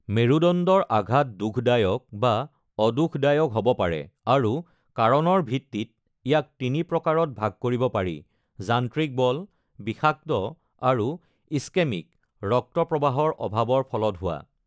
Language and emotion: Assamese, neutral